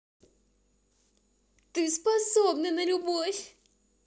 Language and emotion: Russian, positive